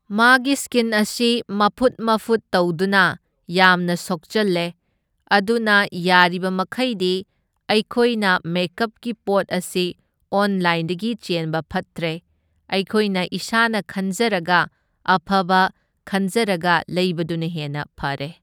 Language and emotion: Manipuri, neutral